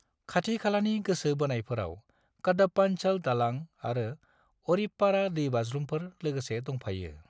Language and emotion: Bodo, neutral